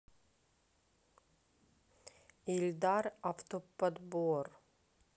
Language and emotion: Russian, neutral